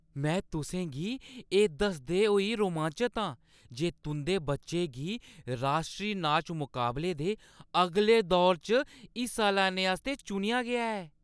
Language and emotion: Dogri, happy